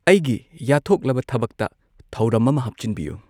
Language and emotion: Manipuri, neutral